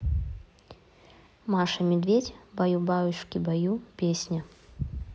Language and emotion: Russian, neutral